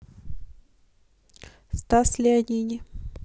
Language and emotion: Russian, neutral